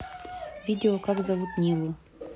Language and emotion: Russian, neutral